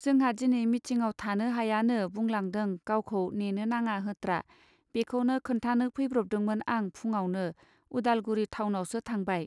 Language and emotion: Bodo, neutral